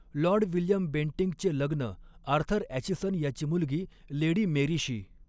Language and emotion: Marathi, neutral